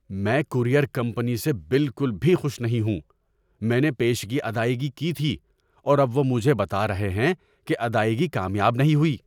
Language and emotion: Urdu, angry